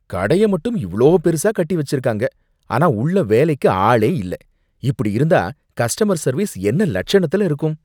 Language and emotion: Tamil, disgusted